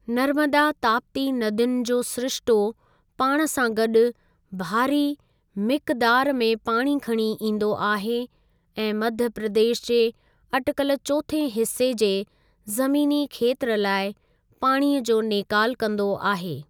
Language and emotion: Sindhi, neutral